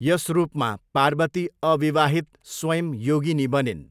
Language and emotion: Nepali, neutral